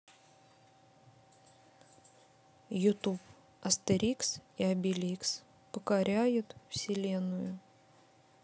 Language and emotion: Russian, neutral